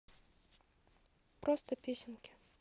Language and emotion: Russian, neutral